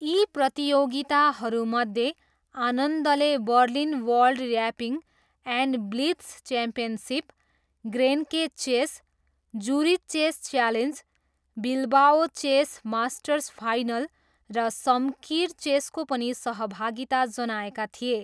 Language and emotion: Nepali, neutral